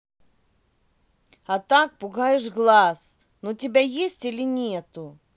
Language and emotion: Russian, angry